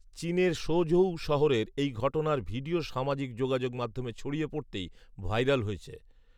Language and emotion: Bengali, neutral